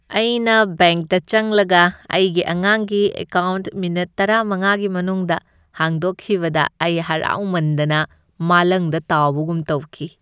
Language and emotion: Manipuri, happy